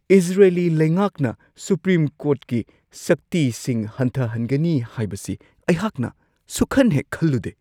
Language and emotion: Manipuri, surprised